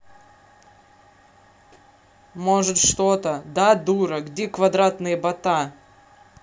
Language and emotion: Russian, angry